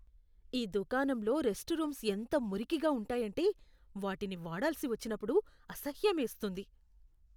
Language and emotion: Telugu, disgusted